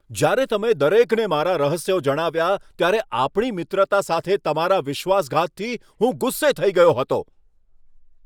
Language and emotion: Gujarati, angry